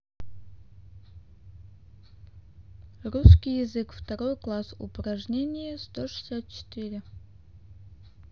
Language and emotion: Russian, neutral